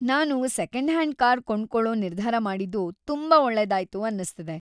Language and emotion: Kannada, happy